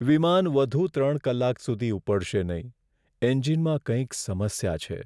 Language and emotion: Gujarati, sad